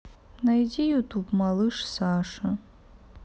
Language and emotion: Russian, sad